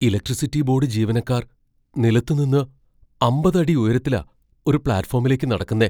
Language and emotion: Malayalam, fearful